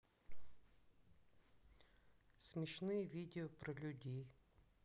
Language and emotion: Russian, neutral